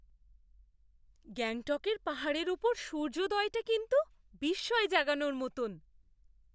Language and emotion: Bengali, surprised